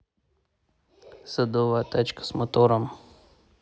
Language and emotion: Russian, neutral